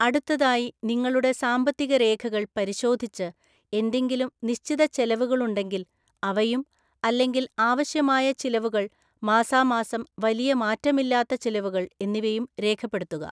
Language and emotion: Malayalam, neutral